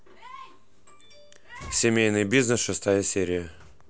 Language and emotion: Russian, neutral